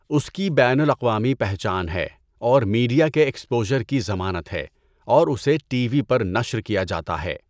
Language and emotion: Urdu, neutral